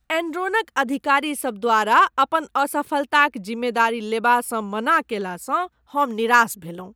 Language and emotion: Maithili, disgusted